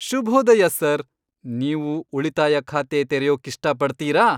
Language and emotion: Kannada, happy